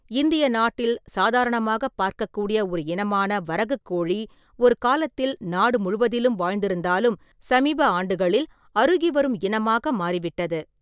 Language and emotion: Tamil, neutral